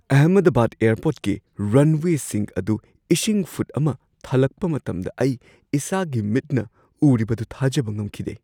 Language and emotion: Manipuri, surprised